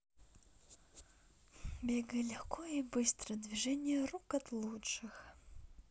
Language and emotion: Russian, neutral